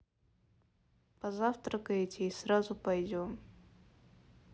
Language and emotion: Russian, neutral